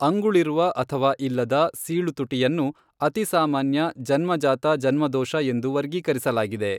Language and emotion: Kannada, neutral